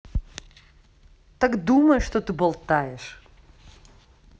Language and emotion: Russian, angry